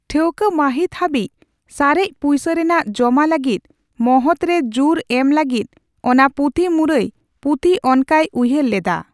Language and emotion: Santali, neutral